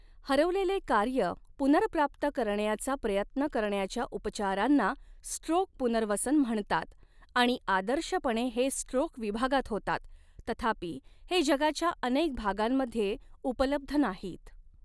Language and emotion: Marathi, neutral